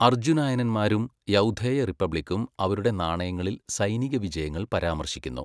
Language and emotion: Malayalam, neutral